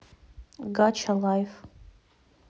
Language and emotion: Russian, neutral